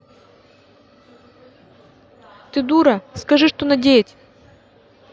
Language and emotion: Russian, angry